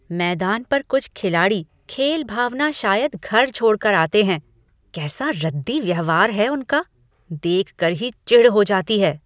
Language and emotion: Hindi, disgusted